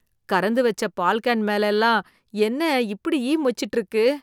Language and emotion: Tamil, disgusted